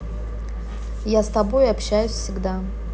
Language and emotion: Russian, neutral